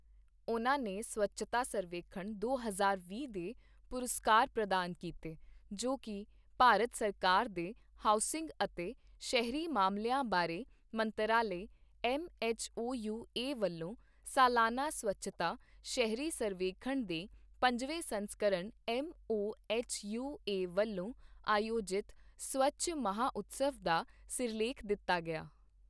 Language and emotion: Punjabi, neutral